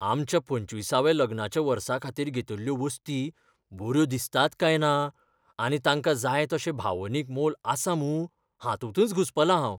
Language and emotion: Goan Konkani, fearful